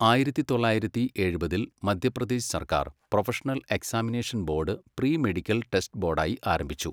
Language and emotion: Malayalam, neutral